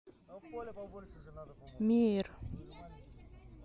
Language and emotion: Russian, neutral